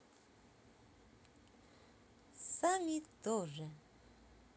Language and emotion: Russian, positive